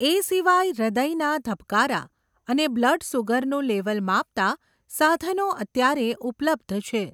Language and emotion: Gujarati, neutral